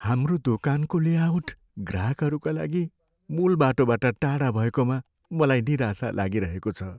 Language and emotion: Nepali, sad